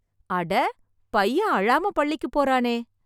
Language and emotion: Tamil, surprised